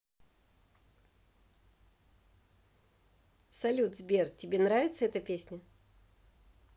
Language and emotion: Russian, positive